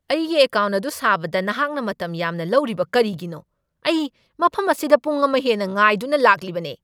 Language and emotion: Manipuri, angry